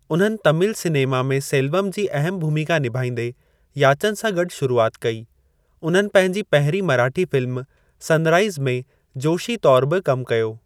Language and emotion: Sindhi, neutral